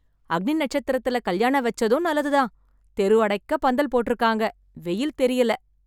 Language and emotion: Tamil, happy